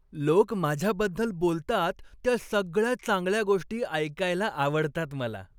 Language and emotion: Marathi, happy